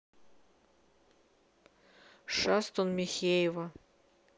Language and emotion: Russian, neutral